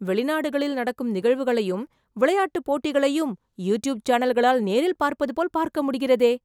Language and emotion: Tamil, surprised